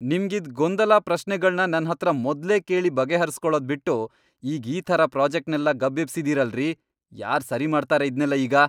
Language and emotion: Kannada, angry